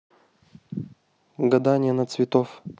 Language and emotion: Russian, neutral